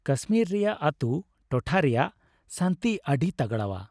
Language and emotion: Santali, happy